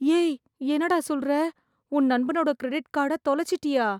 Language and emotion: Tamil, fearful